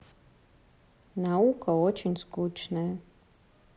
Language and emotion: Russian, sad